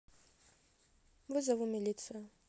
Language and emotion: Russian, neutral